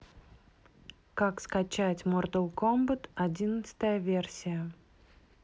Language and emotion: Russian, neutral